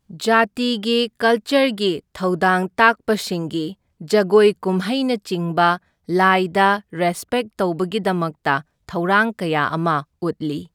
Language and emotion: Manipuri, neutral